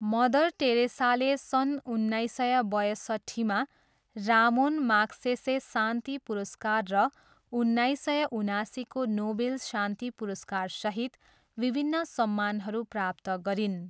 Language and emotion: Nepali, neutral